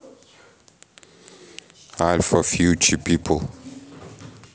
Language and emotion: Russian, neutral